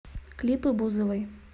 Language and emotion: Russian, neutral